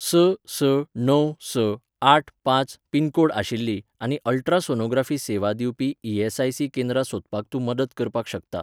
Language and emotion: Goan Konkani, neutral